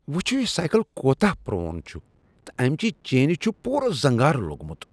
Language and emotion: Kashmiri, disgusted